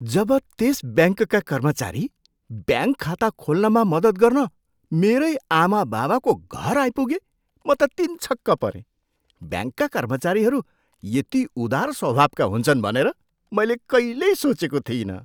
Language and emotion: Nepali, surprised